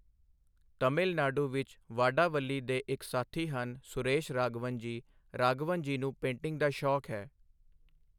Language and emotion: Punjabi, neutral